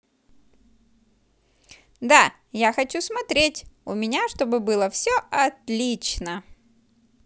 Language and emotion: Russian, positive